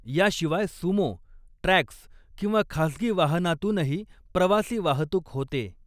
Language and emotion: Marathi, neutral